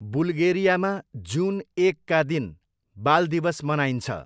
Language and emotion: Nepali, neutral